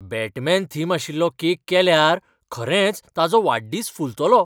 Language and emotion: Goan Konkani, surprised